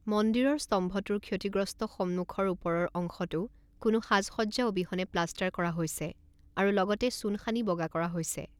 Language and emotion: Assamese, neutral